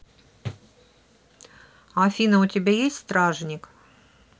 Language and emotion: Russian, neutral